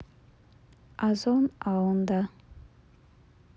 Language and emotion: Russian, neutral